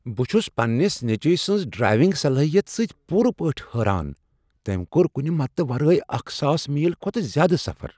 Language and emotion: Kashmiri, surprised